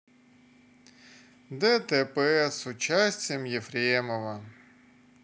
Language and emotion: Russian, sad